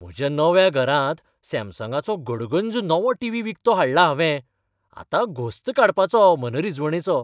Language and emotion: Goan Konkani, happy